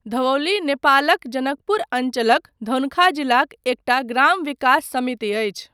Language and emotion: Maithili, neutral